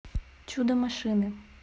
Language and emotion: Russian, neutral